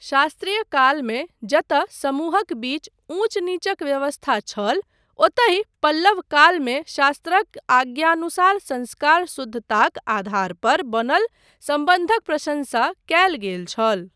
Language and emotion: Maithili, neutral